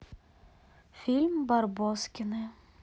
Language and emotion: Russian, neutral